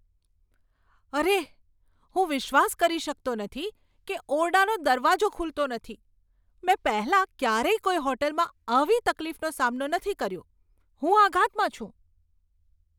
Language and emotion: Gujarati, surprised